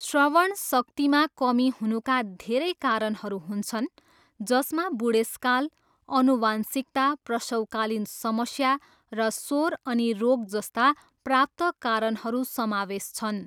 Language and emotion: Nepali, neutral